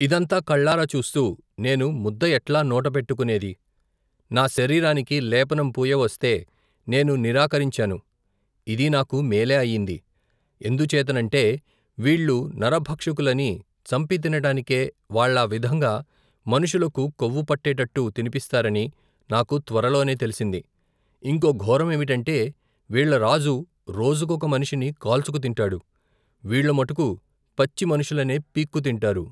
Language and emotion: Telugu, neutral